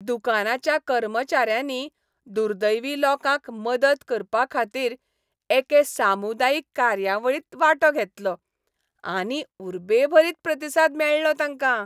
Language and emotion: Goan Konkani, happy